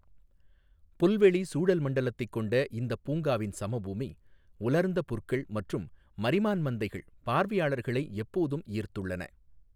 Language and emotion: Tamil, neutral